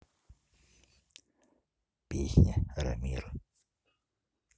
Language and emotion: Russian, neutral